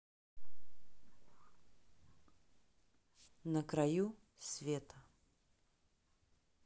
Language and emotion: Russian, neutral